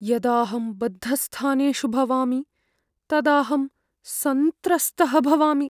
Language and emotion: Sanskrit, fearful